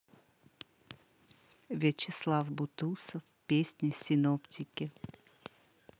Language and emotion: Russian, positive